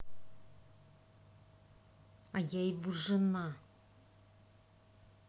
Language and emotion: Russian, angry